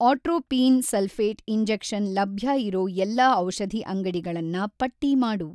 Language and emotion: Kannada, neutral